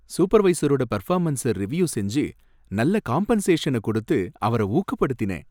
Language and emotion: Tamil, happy